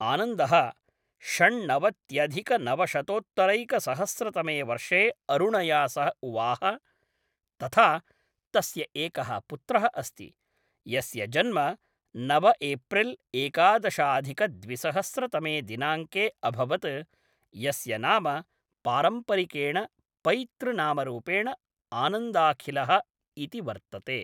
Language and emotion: Sanskrit, neutral